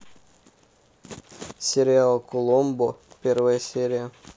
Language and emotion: Russian, neutral